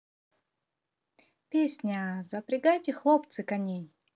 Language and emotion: Russian, positive